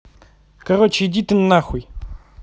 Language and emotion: Russian, angry